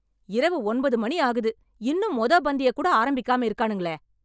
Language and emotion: Tamil, angry